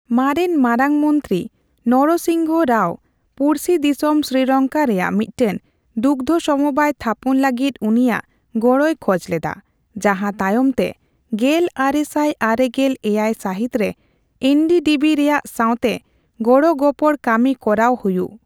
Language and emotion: Santali, neutral